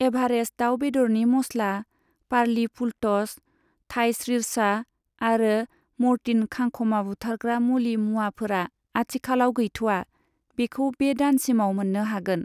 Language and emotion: Bodo, neutral